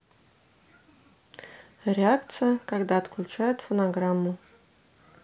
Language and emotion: Russian, neutral